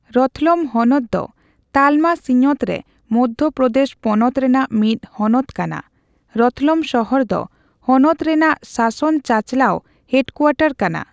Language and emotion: Santali, neutral